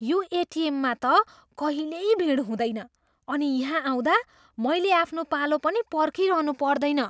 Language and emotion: Nepali, surprised